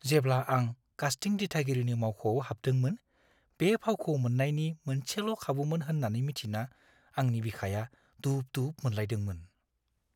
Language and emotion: Bodo, fearful